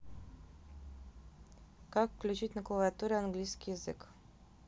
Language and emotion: Russian, neutral